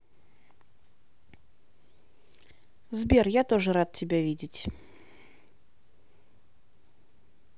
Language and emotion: Russian, neutral